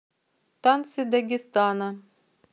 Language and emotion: Russian, neutral